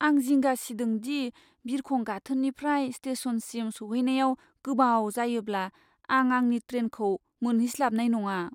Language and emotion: Bodo, fearful